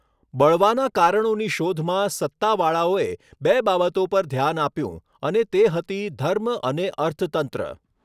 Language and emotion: Gujarati, neutral